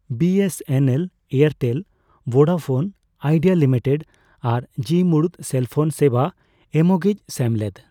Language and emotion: Santali, neutral